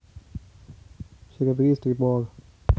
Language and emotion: Russian, neutral